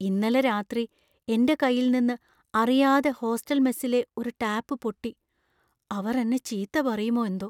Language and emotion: Malayalam, fearful